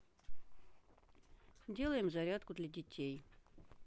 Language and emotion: Russian, neutral